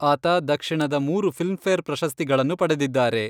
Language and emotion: Kannada, neutral